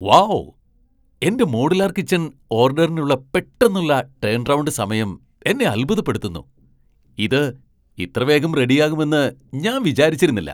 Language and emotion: Malayalam, surprised